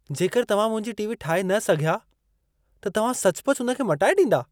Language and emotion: Sindhi, surprised